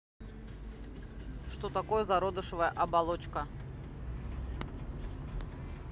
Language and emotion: Russian, neutral